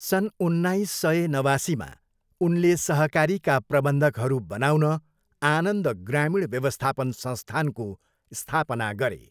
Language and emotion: Nepali, neutral